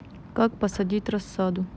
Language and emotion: Russian, neutral